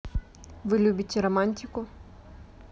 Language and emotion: Russian, neutral